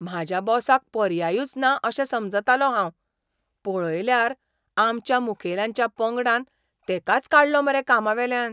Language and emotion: Goan Konkani, surprised